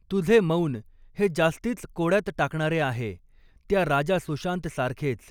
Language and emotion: Marathi, neutral